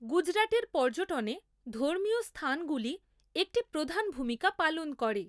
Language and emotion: Bengali, neutral